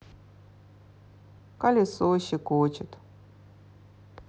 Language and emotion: Russian, neutral